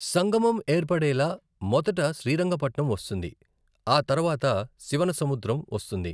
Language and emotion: Telugu, neutral